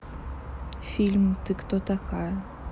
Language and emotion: Russian, neutral